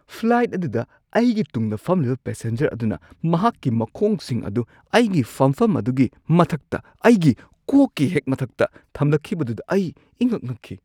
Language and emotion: Manipuri, surprised